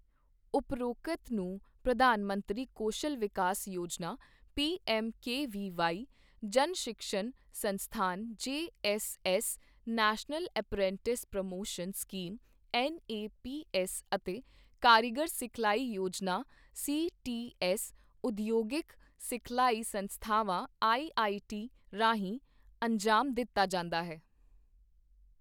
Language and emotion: Punjabi, neutral